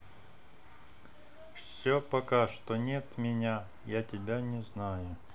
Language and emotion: Russian, neutral